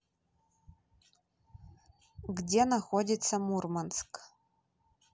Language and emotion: Russian, neutral